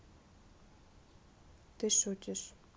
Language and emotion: Russian, neutral